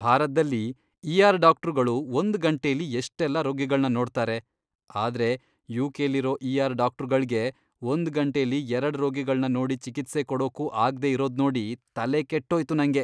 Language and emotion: Kannada, disgusted